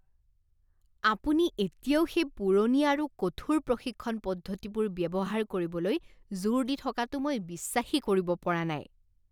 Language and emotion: Assamese, disgusted